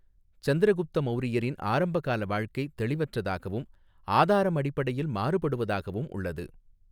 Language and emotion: Tamil, neutral